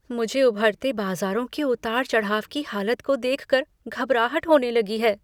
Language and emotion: Hindi, fearful